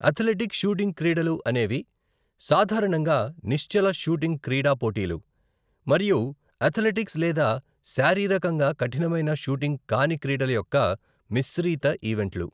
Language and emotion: Telugu, neutral